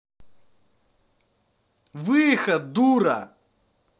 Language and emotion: Russian, angry